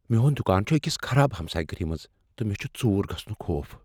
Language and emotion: Kashmiri, fearful